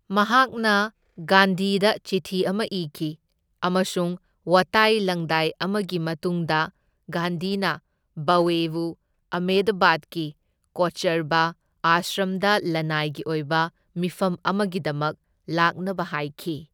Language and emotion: Manipuri, neutral